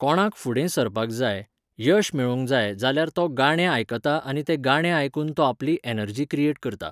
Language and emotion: Goan Konkani, neutral